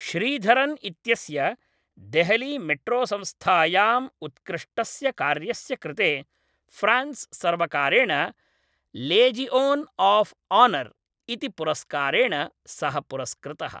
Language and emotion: Sanskrit, neutral